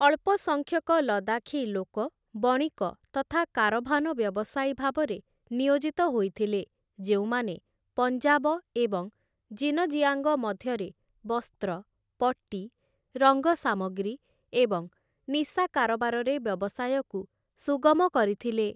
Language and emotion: Odia, neutral